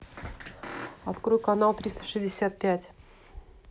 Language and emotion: Russian, neutral